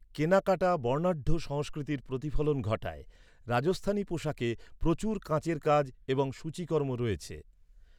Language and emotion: Bengali, neutral